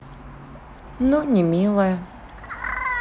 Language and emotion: Russian, neutral